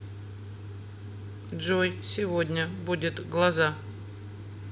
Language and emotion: Russian, neutral